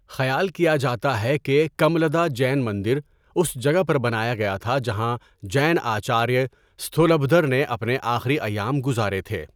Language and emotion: Urdu, neutral